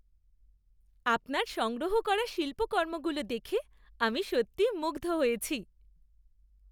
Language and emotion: Bengali, happy